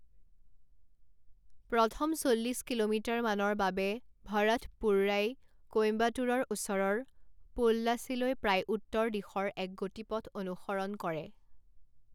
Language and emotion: Assamese, neutral